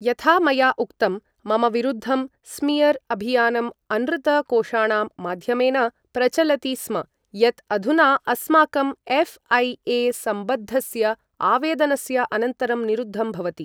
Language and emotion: Sanskrit, neutral